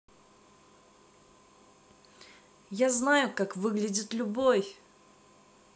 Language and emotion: Russian, positive